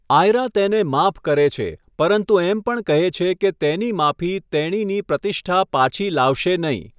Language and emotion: Gujarati, neutral